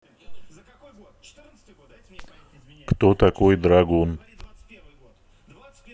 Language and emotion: Russian, neutral